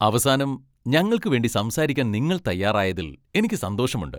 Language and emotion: Malayalam, happy